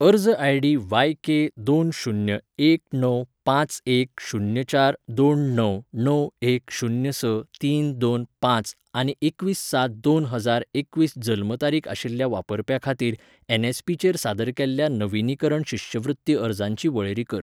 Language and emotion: Goan Konkani, neutral